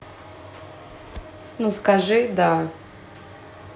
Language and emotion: Russian, neutral